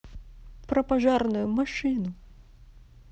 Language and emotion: Russian, neutral